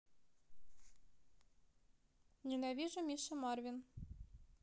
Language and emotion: Russian, neutral